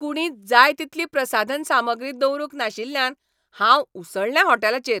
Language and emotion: Goan Konkani, angry